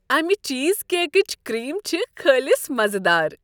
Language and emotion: Kashmiri, happy